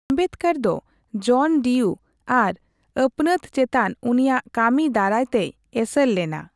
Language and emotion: Santali, neutral